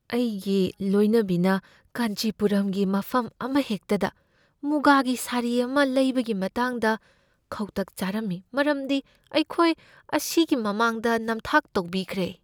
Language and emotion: Manipuri, fearful